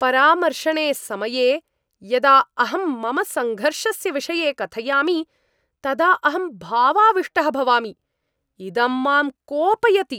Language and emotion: Sanskrit, angry